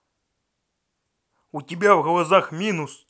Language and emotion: Russian, angry